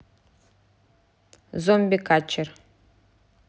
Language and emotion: Russian, neutral